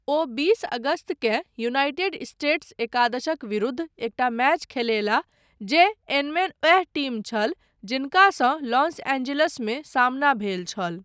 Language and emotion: Maithili, neutral